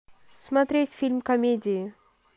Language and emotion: Russian, neutral